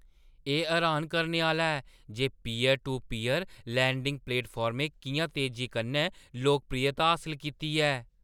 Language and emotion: Dogri, surprised